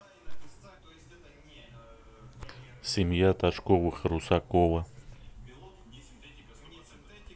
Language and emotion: Russian, neutral